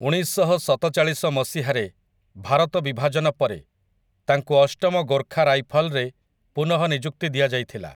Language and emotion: Odia, neutral